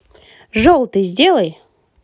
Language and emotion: Russian, positive